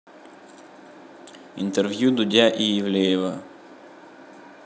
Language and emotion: Russian, neutral